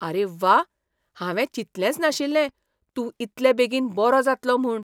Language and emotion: Goan Konkani, surprised